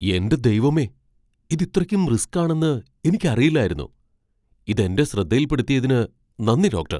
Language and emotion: Malayalam, surprised